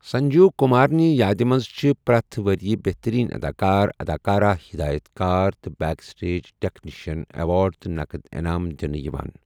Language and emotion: Kashmiri, neutral